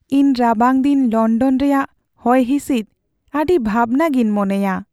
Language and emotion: Santali, sad